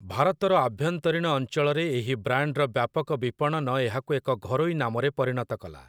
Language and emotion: Odia, neutral